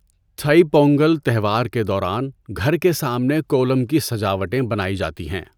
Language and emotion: Urdu, neutral